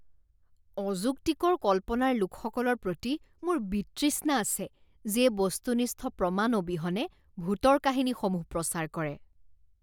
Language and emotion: Assamese, disgusted